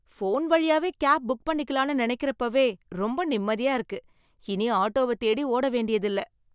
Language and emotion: Tamil, happy